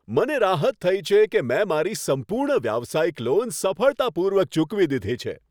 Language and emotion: Gujarati, happy